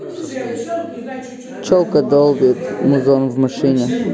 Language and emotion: Russian, neutral